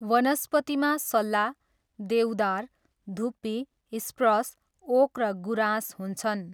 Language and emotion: Nepali, neutral